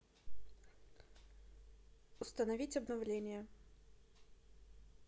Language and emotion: Russian, neutral